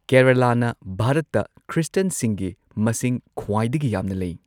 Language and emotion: Manipuri, neutral